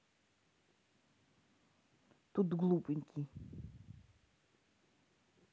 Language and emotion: Russian, neutral